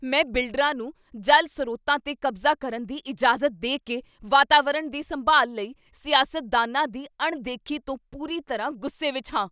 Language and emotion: Punjabi, angry